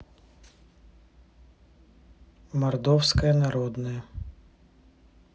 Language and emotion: Russian, neutral